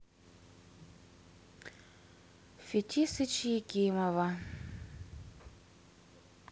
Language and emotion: Russian, sad